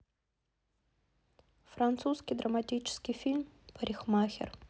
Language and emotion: Russian, neutral